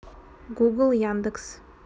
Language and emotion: Russian, neutral